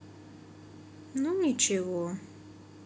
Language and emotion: Russian, neutral